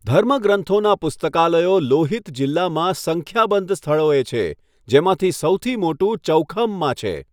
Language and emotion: Gujarati, neutral